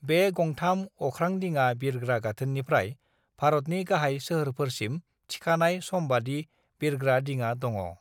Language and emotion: Bodo, neutral